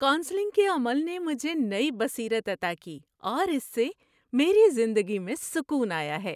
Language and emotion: Urdu, happy